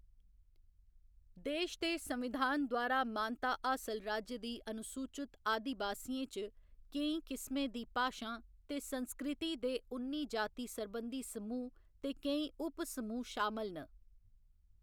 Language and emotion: Dogri, neutral